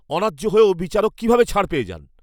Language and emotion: Bengali, angry